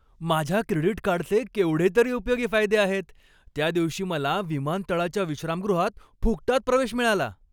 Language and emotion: Marathi, happy